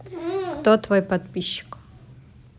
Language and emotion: Russian, neutral